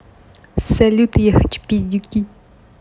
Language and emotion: Russian, positive